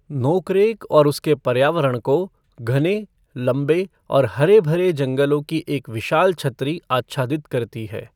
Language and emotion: Hindi, neutral